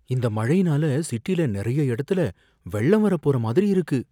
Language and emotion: Tamil, fearful